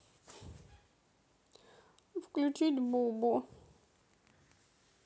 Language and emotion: Russian, sad